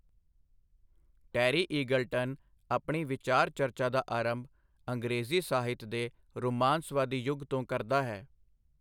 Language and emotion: Punjabi, neutral